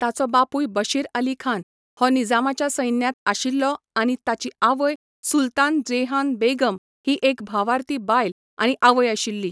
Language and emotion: Goan Konkani, neutral